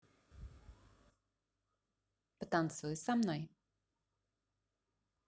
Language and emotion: Russian, positive